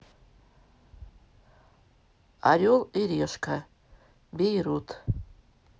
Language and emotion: Russian, neutral